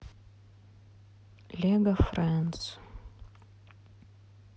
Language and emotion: Russian, neutral